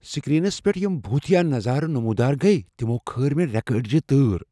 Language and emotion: Kashmiri, fearful